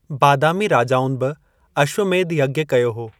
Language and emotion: Sindhi, neutral